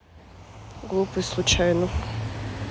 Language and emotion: Russian, neutral